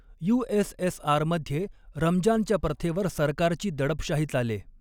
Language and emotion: Marathi, neutral